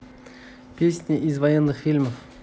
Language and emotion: Russian, neutral